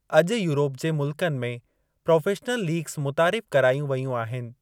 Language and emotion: Sindhi, neutral